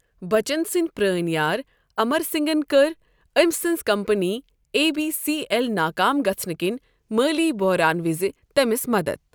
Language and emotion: Kashmiri, neutral